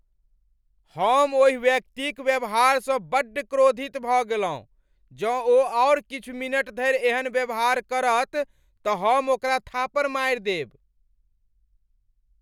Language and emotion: Maithili, angry